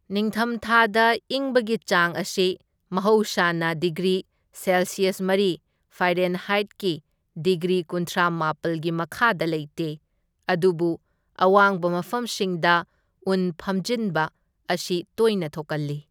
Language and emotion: Manipuri, neutral